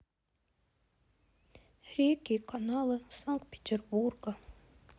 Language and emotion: Russian, sad